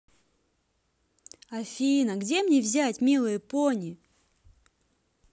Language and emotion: Russian, neutral